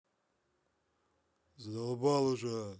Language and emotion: Russian, angry